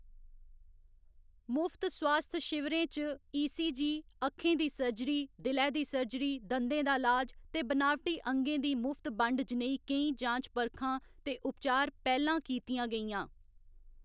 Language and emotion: Dogri, neutral